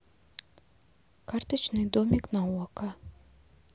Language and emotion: Russian, neutral